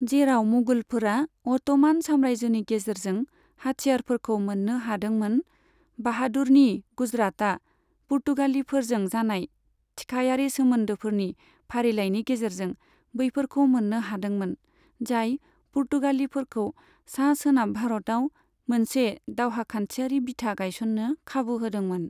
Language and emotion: Bodo, neutral